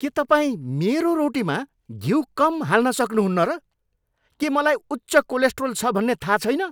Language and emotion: Nepali, angry